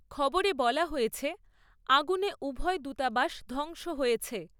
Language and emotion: Bengali, neutral